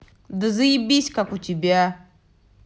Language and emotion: Russian, angry